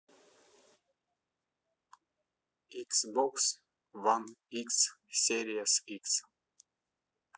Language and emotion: Russian, neutral